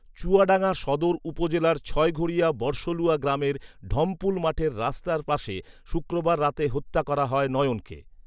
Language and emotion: Bengali, neutral